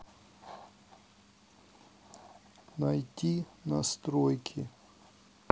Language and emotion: Russian, neutral